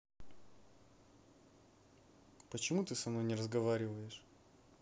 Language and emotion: Russian, sad